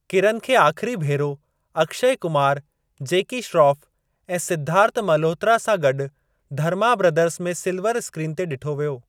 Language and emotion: Sindhi, neutral